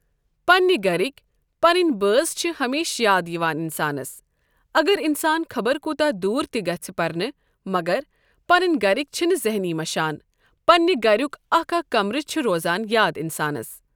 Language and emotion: Kashmiri, neutral